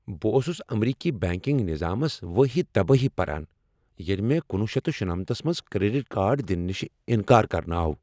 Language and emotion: Kashmiri, angry